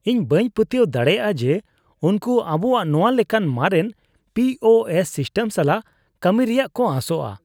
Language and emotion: Santali, disgusted